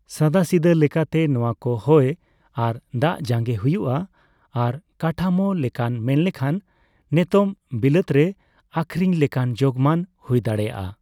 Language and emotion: Santali, neutral